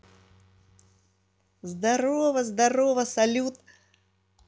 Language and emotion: Russian, positive